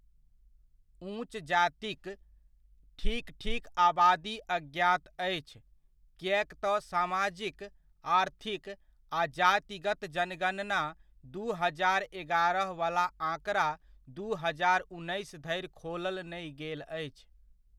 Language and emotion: Maithili, neutral